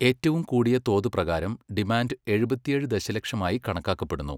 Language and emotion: Malayalam, neutral